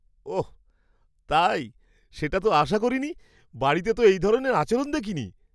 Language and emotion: Bengali, surprised